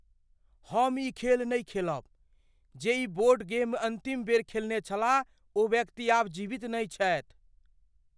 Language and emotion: Maithili, fearful